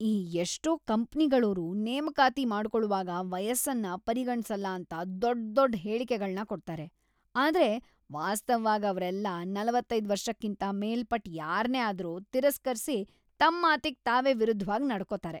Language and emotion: Kannada, disgusted